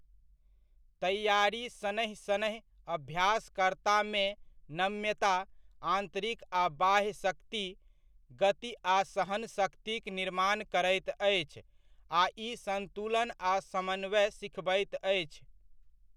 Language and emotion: Maithili, neutral